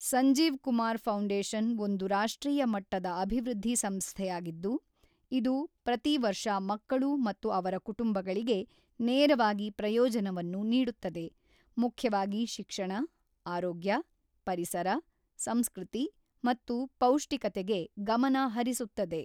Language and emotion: Kannada, neutral